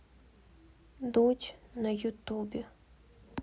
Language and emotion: Russian, sad